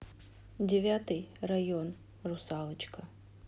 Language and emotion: Russian, neutral